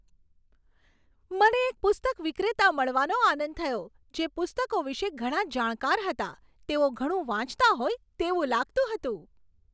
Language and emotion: Gujarati, happy